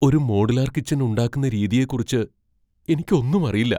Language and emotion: Malayalam, fearful